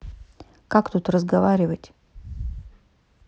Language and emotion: Russian, neutral